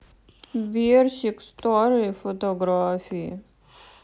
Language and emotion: Russian, sad